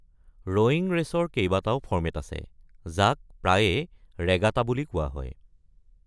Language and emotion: Assamese, neutral